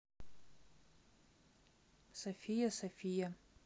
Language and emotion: Russian, neutral